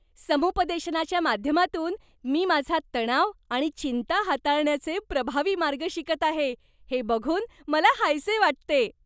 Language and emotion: Marathi, happy